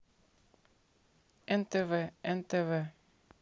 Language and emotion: Russian, neutral